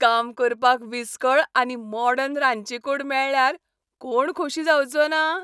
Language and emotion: Goan Konkani, happy